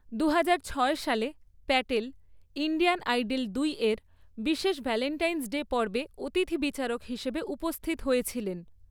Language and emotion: Bengali, neutral